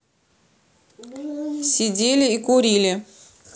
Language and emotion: Russian, neutral